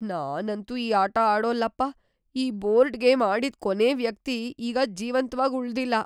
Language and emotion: Kannada, fearful